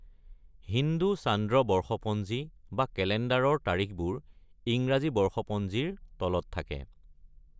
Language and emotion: Assamese, neutral